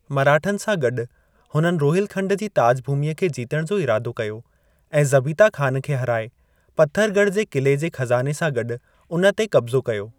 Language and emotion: Sindhi, neutral